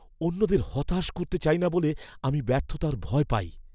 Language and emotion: Bengali, fearful